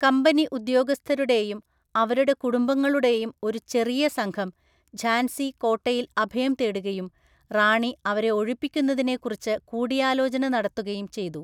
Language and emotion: Malayalam, neutral